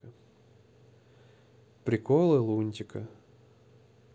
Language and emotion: Russian, neutral